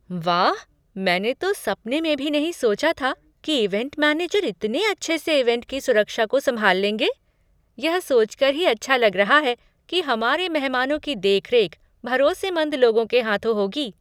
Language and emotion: Hindi, surprised